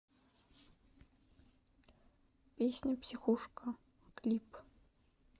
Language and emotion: Russian, neutral